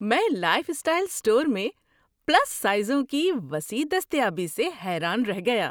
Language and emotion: Urdu, surprised